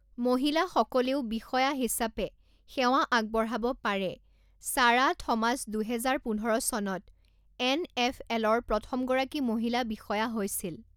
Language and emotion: Assamese, neutral